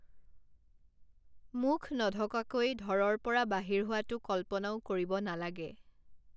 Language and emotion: Assamese, neutral